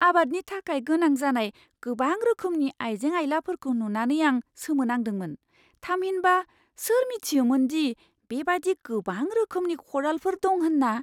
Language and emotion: Bodo, surprised